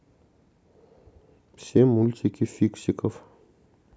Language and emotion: Russian, neutral